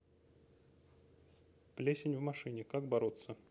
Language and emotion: Russian, neutral